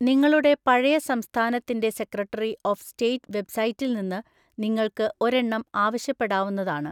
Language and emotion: Malayalam, neutral